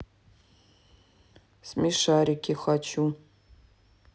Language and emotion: Russian, neutral